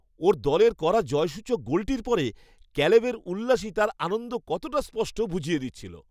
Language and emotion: Bengali, happy